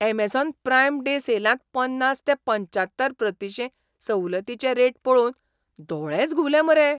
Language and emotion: Goan Konkani, surprised